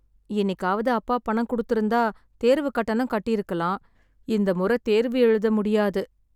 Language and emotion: Tamil, sad